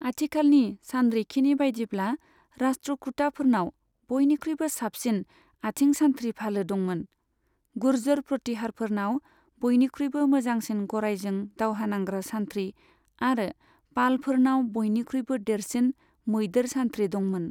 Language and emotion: Bodo, neutral